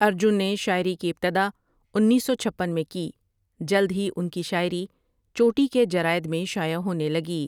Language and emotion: Urdu, neutral